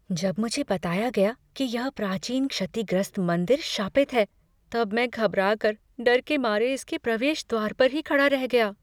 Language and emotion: Hindi, fearful